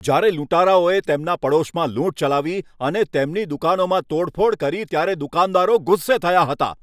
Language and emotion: Gujarati, angry